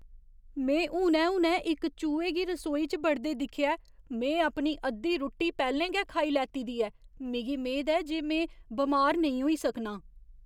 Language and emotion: Dogri, fearful